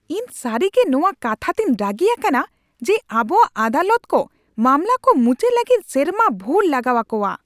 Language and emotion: Santali, angry